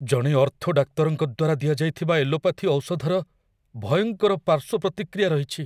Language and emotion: Odia, fearful